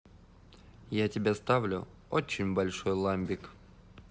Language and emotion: Russian, positive